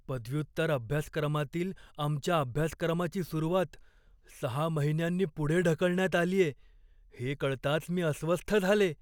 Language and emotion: Marathi, fearful